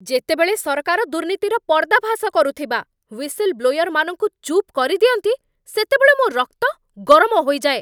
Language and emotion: Odia, angry